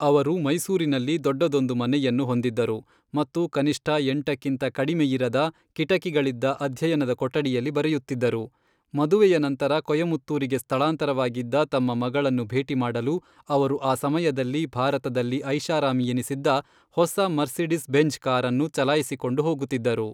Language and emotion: Kannada, neutral